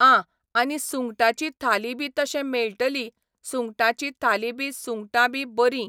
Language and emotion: Goan Konkani, neutral